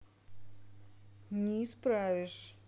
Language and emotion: Russian, neutral